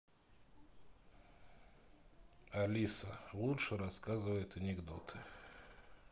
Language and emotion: Russian, sad